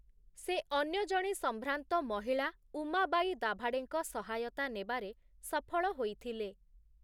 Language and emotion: Odia, neutral